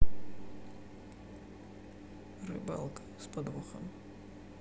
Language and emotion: Russian, sad